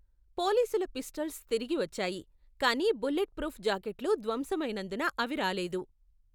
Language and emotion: Telugu, neutral